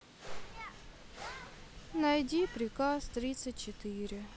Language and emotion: Russian, sad